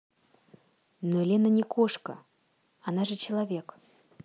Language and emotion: Russian, neutral